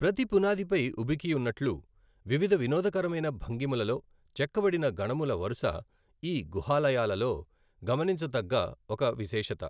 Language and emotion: Telugu, neutral